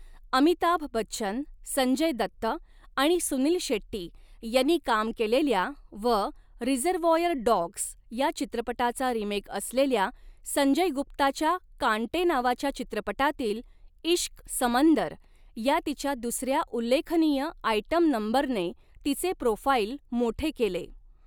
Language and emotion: Marathi, neutral